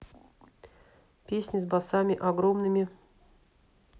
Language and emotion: Russian, neutral